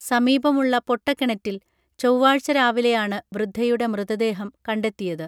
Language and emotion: Malayalam, neutral